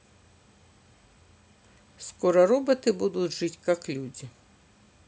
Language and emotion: Russian, neutral